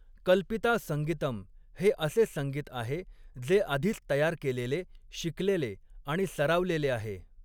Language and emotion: Marathi, neutral